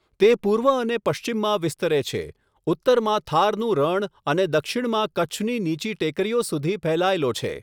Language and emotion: Gujarati, neutral